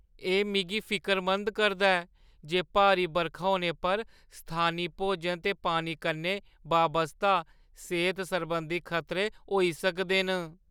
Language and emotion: Dogri, fearful